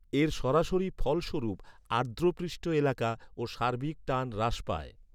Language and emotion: Bengali, neutral